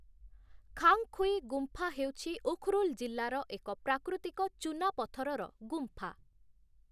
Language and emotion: Odia, neutral